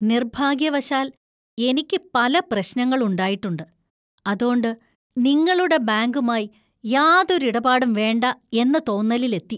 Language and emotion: Malayalam, disgusted